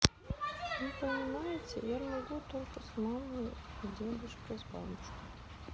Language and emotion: Russian, sad